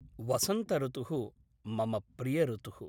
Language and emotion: Sanskrit, neutral